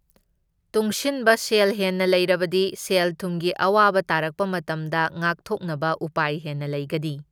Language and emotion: Manipuri, neutral